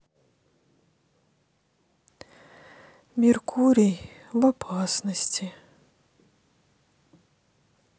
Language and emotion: Russian, sad